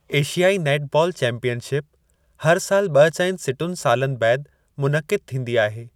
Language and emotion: Sindhi, neutral